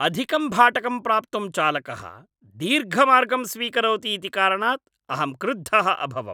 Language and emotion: Sanskrit, angry